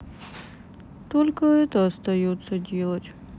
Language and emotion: Russian, sad